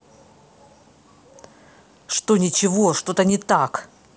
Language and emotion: Russian, angry